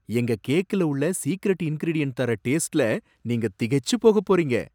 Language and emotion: Tamil, surprised